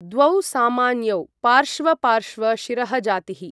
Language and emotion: Sanskrit, neutral